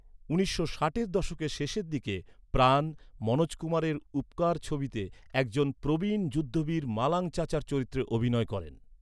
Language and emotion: Bengali, neutral